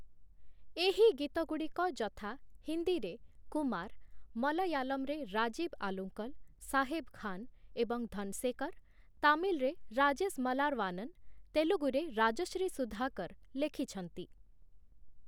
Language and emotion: Odia, neutral